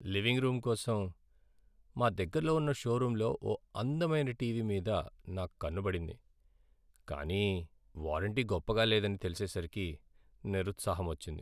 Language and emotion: Telugu, sad